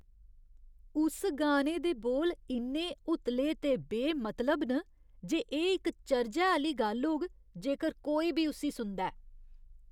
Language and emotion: Dogri, disgusted